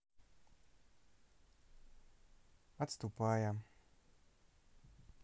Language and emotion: Russian, neutral